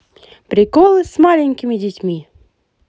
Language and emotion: Russian, positive